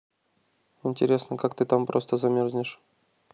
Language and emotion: Russian, neutral